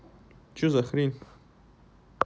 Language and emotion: Russian, angry